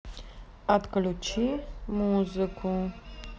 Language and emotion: Russian, neutral